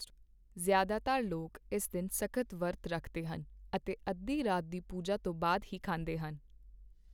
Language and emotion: Punjabi, neutral